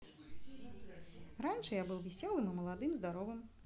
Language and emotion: Russian, positive